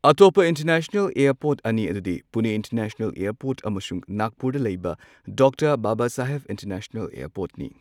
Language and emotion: Manipuri, neutral